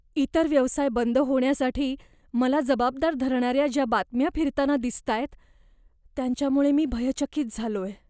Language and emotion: Marathi, fearful